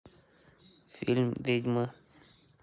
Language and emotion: Russian, neutral